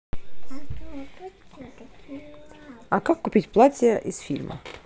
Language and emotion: Russian, neutral